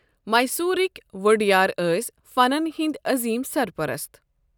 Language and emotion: Kashmiri, neutral